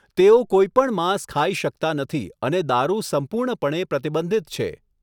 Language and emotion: Gujarati, neutral